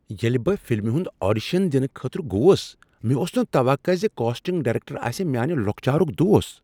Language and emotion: Kashmiri, surprised